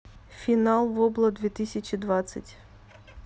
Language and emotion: Russian, neutral